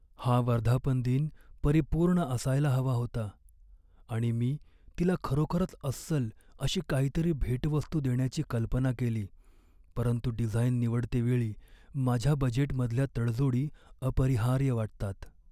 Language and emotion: Marathi, sad